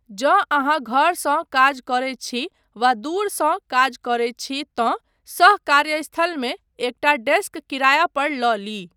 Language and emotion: Maithili, neutral